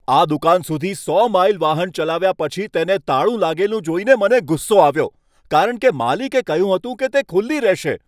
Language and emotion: Gujarati, angry